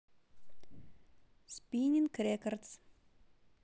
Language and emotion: Russian, neutral